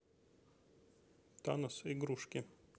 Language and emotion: Russian, neutral